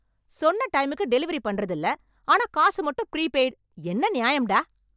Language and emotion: Tamil, angry